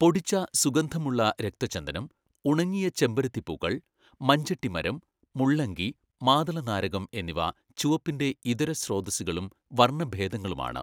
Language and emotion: Malayalam, neutral